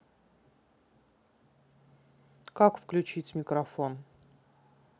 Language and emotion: Russian, neutral